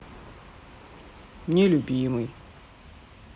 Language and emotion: Russian, sad